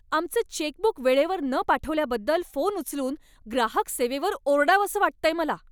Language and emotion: Marathi, angry